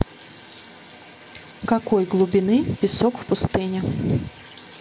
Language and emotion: Russian, neutral